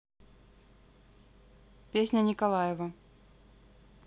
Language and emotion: Russian, neutral